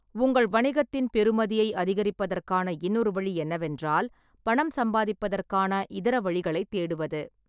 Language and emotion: Tamil, neutral